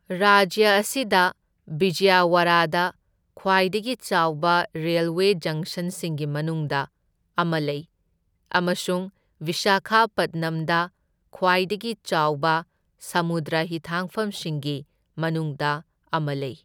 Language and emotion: Manipuri, neutral